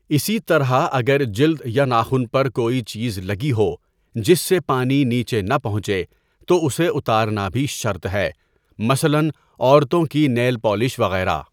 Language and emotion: Urdu, neutral